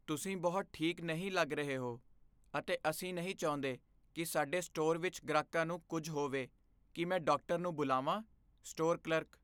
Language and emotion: Punjabi, fearful